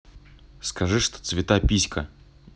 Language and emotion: Russian, neutral